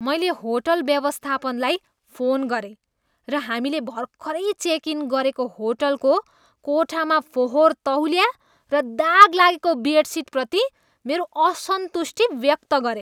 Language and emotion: Nepali, disgusted